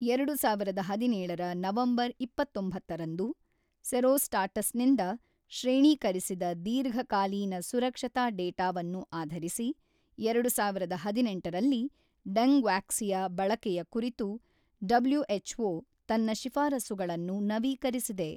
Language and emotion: Kannada, neutral